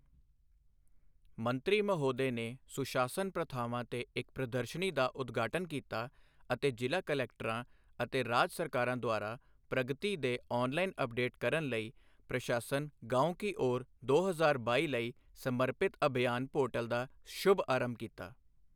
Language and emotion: Punjabi, neutral